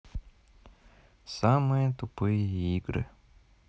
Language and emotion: Russian, sad